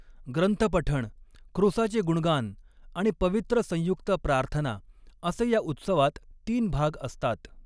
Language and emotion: Marathi, neutral